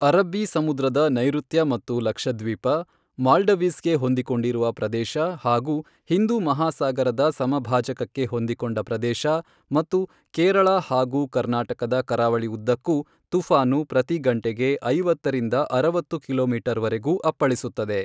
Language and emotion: Kannada, neutral